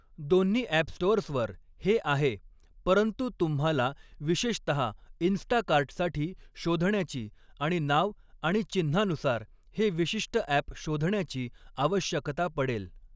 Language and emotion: Marathi, neutral